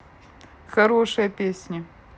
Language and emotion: Russian, neutral